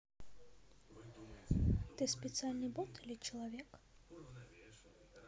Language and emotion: Russian, neutral